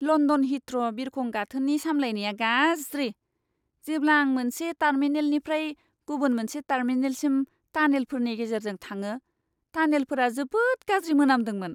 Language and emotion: Bodo, disgusted